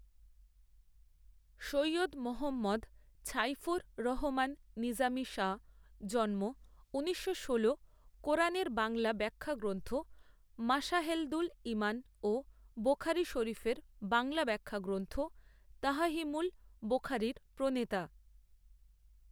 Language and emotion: Bengali, neutral